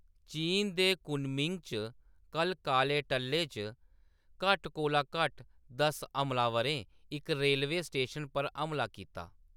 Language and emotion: Dogri, neutral